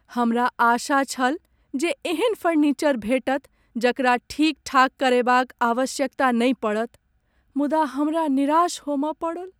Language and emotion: Maithili, sad